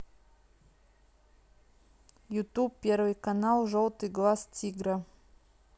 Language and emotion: Russian, neutral